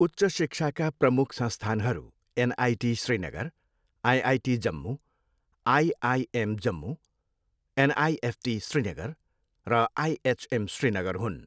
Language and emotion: Nepali, neutral